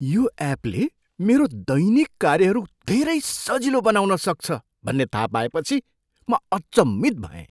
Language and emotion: Nepali, surprised